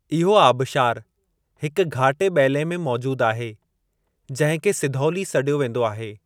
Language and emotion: Sindhi, neutral